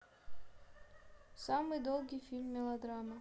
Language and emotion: Russian, neutral